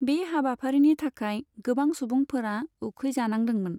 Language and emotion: Bodo, neutral